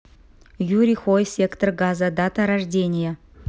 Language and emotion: Russian, neutral